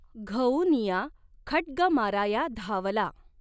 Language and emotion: Marathi, neutral